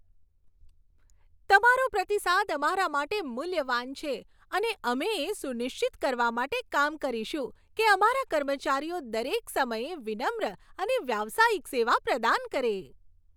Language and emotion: Gujarati, happy